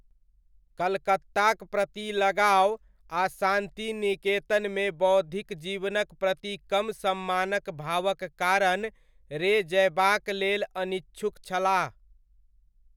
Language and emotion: Maithili, neutral